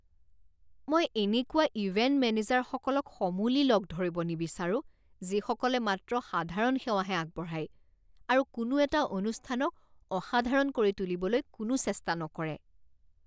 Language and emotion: Assamese, disgusted